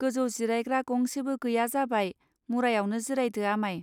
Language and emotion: Bodo, neutral